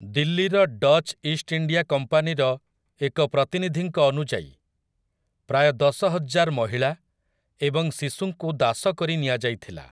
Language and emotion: Odia, neutral